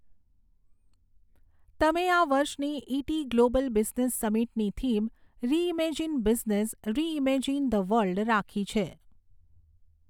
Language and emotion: Gujarati, neutral